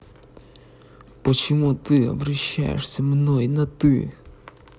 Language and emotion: Russian, angry